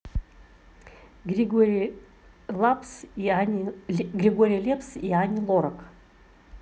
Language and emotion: Russian, neutral